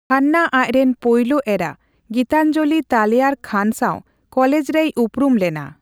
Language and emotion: Santali, neutral